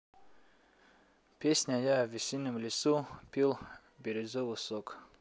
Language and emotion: Russian, neutral